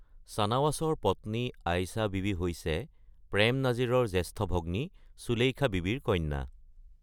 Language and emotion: Assamese, neutral